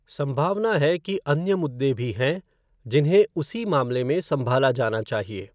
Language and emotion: Hindi, neutral